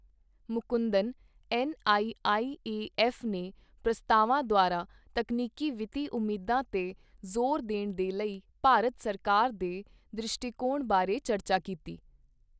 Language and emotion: Punjabi, neutral